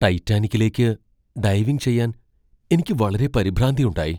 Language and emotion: Malayalam, fearful